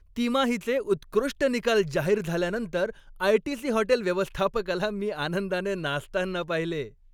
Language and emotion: Marathi, happy